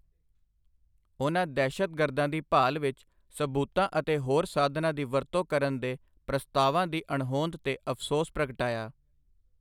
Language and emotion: Punjabi, neutral